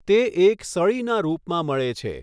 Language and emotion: Gujarati, neutral